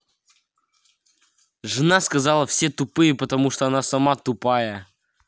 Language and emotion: Russian, angry